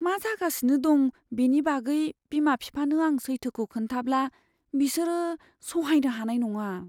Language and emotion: Bodo, fearful